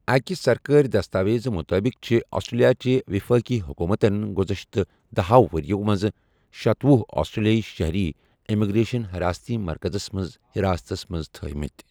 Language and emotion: Kashmiri, neutral